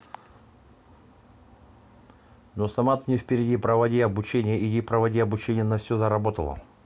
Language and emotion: Russian, neutral